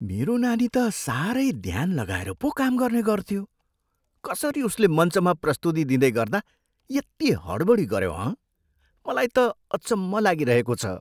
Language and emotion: Nepali, surprised